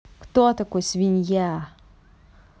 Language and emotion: Russian, angry